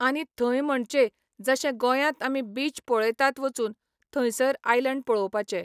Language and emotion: Goan Konkani, neutral